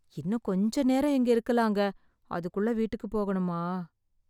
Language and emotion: Tamil, sad